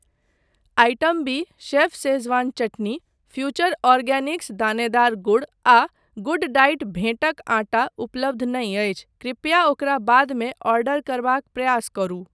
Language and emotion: Maithili, neutral